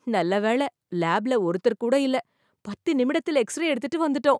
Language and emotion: Tamil, surprised